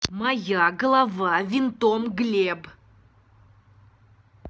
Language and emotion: Russian, angry